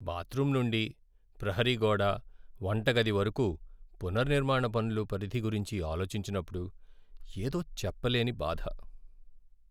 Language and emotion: Telugu, sad